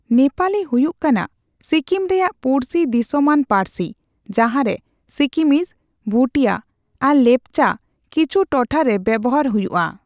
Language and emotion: Santali, neutral